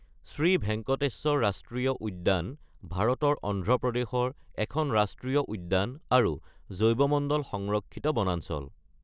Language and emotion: Assamese, neutral